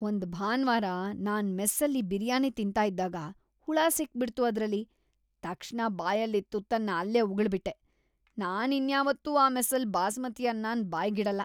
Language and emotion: Kannada, disgusted